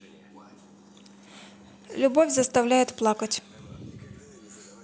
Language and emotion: Russian, neutral